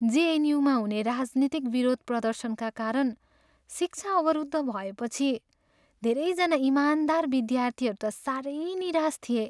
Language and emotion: Nepali, sad